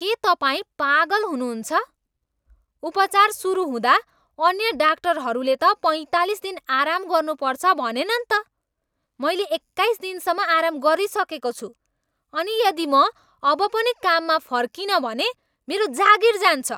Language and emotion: Nepali, angry